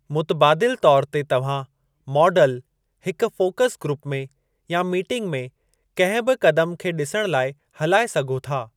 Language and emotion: Sindhi, neutral